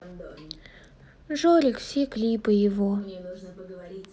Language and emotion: Russian, sad